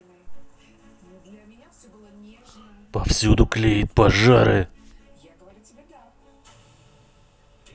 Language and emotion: Russian, angry